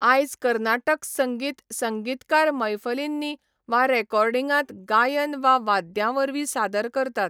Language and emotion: Goan Konkani, neutral